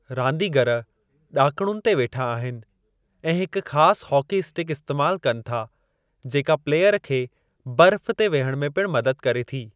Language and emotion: Sindhi, neutral